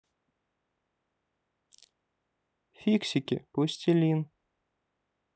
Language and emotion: Russian, neutral